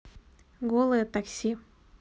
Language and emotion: Russian, neutral